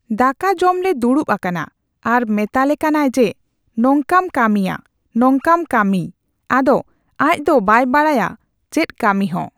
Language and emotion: Santali, neutral